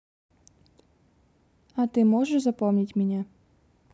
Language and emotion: Russian, neutral